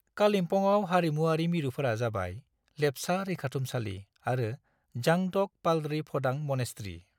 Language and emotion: Bodo, neutral